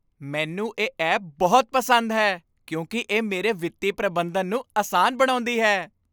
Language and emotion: Punjabi, happy